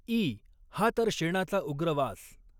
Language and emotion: Marathi, neutral